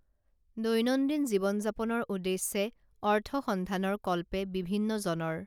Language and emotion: Assamese, neutral